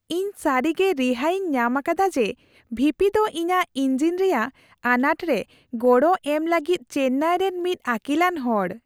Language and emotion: Santali, happy